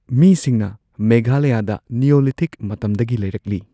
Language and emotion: Manipuri, neutral